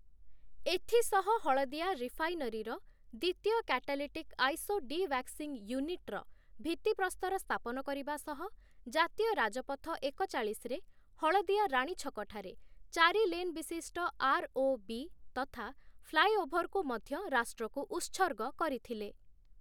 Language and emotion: Odia, neutral